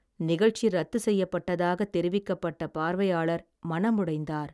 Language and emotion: Tamil, sad